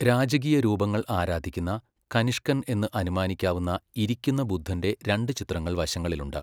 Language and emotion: Malayalam, neutral